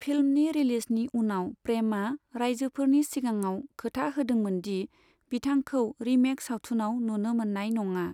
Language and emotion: Bodo, neutral